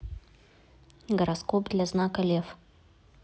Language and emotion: Russian, neutral